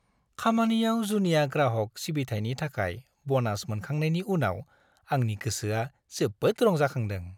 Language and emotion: Bodo, happy